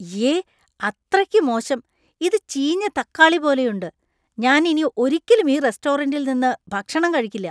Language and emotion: Malayalam, disgusted